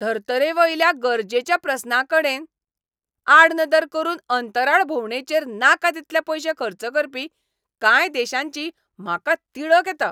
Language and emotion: Goan Konkani, angry